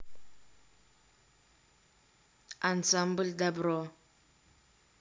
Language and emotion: Russian, neutral